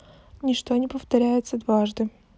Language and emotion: Russian, neutral